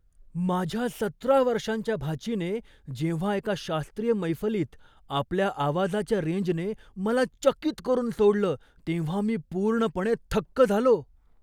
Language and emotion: Marathi, surprised